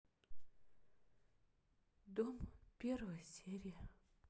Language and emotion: Russian, sad